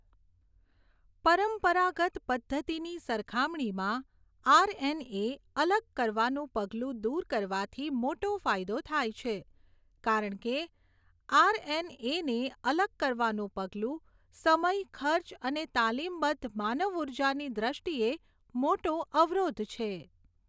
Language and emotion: Gujarati, neutral